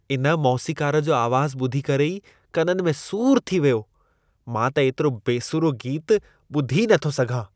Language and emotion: Sindhi, disgusted